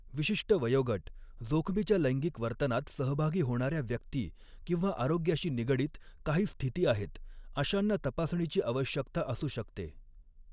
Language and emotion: Marathi, neutral